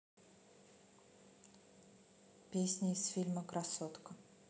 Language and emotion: Russian, neutral